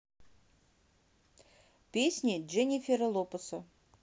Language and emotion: Russian, neutral